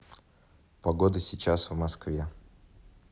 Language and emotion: Russian, neutral